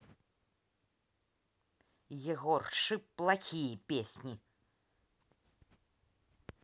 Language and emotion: Russian, angry